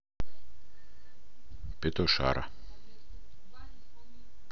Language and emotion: Russian, neutral